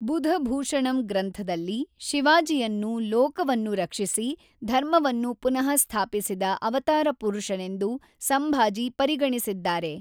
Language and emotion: Kannada, neutral